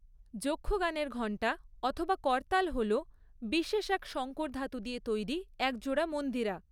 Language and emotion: Bengali, neutral